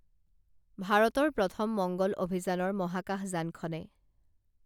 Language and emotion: Assamese, neutral